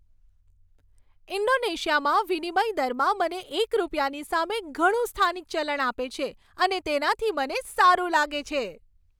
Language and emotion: Gujarati, happy